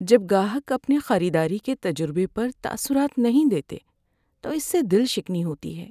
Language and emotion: Urdu, sad